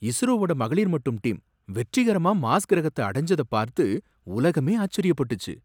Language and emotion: Tamil, surprised